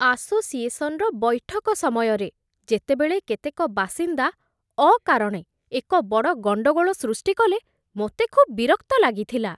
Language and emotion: Odia, disgusted